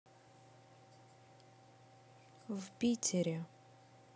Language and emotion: Russian, neutral